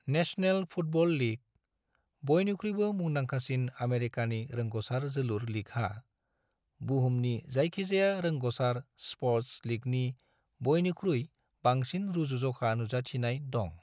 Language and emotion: Bodo, neutral